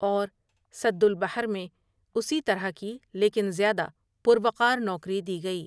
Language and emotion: Urdu, neutral